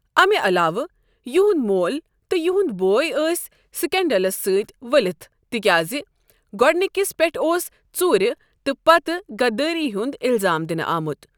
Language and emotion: Kashmiri, neutral